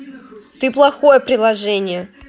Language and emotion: Russian, angry